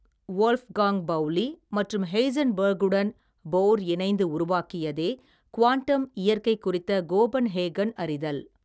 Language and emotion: Tamil, neutral